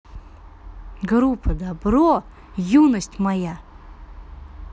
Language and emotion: Russian, positive